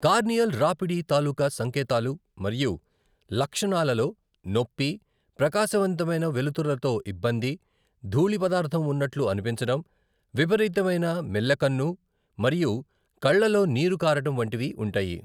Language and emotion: Telugu, neutral